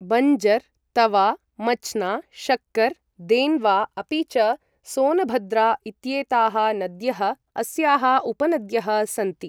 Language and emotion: Sanskrit, neutral